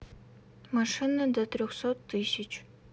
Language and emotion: Russian, neutral